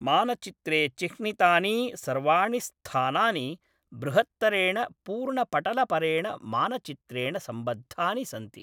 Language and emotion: Sanskrit, neutral